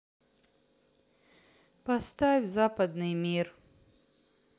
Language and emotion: Russian, sad